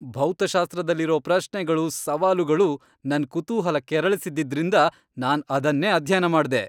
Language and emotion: Kannada, happy